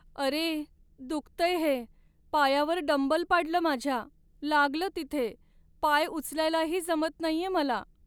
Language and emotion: Marathi, sad